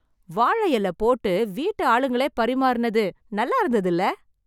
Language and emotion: Tamil, happy